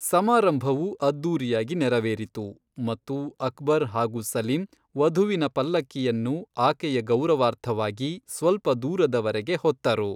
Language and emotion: Kannada, neutral